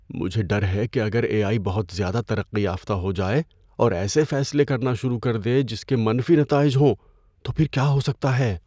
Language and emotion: Urdu, fearful